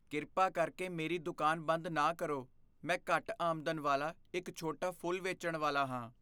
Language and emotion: Punjabi, fearful